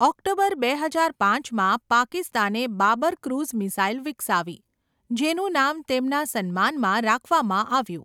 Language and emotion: Gujarati, neutral